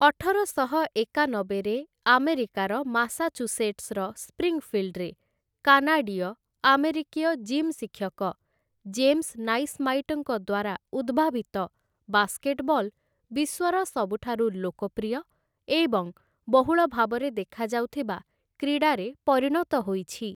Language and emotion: Odia, neutral